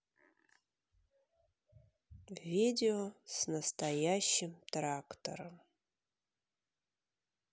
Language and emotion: Russian, sad